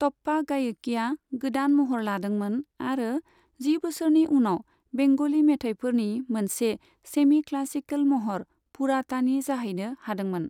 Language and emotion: Bodo, neutral